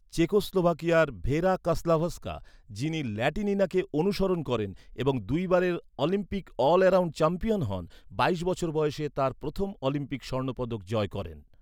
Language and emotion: Bengali, neutral